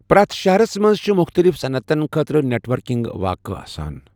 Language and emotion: Kashmiri, neutral